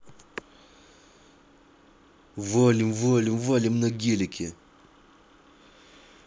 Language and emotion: Russian, angry